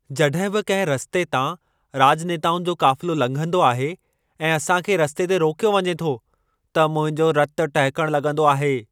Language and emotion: Sindhi, angry